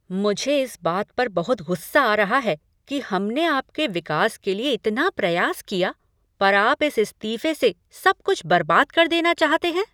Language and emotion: Hindi, angry